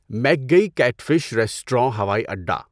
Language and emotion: Urdu, neutral